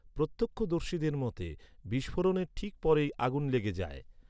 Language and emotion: Bengali, neutral